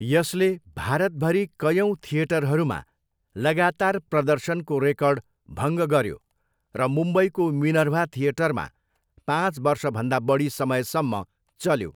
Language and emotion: Nepali, neutral